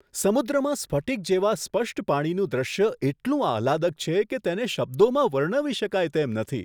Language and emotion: Gujarati, surprised